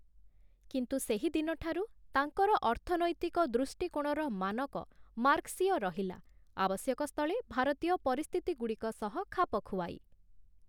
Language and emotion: Odia, neutral